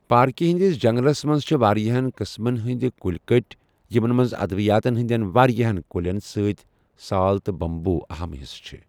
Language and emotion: Kashmiri, neutral